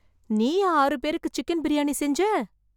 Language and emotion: Tamil, surprised